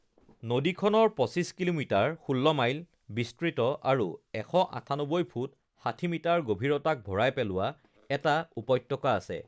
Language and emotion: Assamese, neutral